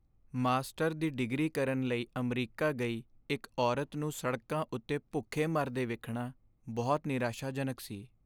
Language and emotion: Punjabi, sad